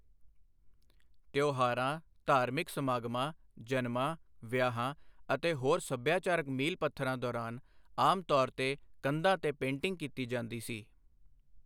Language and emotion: Punjabi, neutral